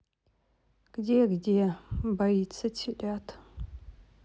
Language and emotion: Russian, sad